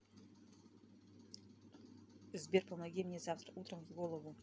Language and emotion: Russian, neutral